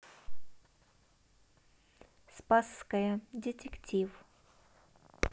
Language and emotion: Russian, neutral